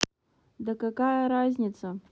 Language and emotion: Russian, neutral